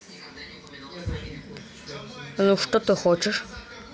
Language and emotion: Russian, neutral